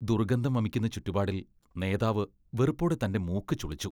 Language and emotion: Malayalam, disgusted